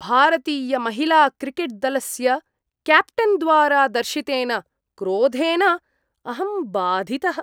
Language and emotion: Sanskrit, disgusted